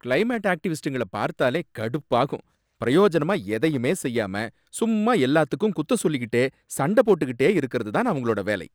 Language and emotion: Tamil, angry